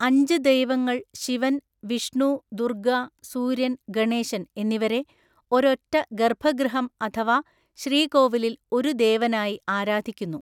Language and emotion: Malayalam, neutral